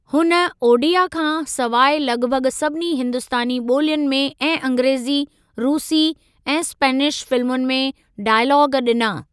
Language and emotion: Sindhi, neutral